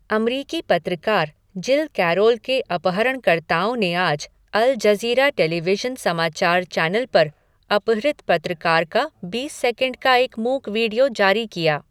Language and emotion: Hindi, neutral